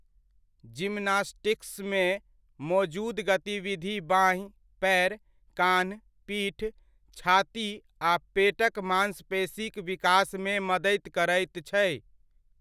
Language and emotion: Maithili, neutral